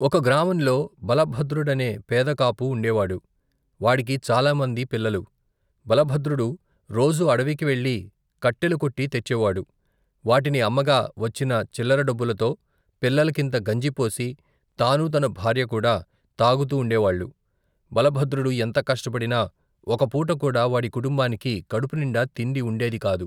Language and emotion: Telugu, neutral